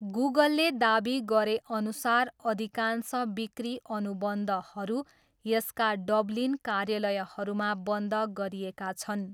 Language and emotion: Nepali, neutral